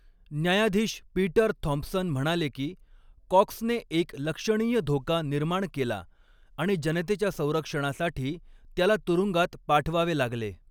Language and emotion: Marathi, neutral